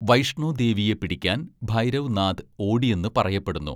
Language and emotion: Malayalam, neutral